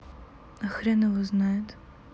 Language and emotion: Russian, sad